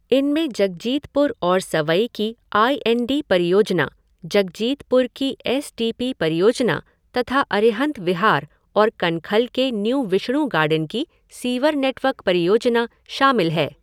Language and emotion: Hindi, neutral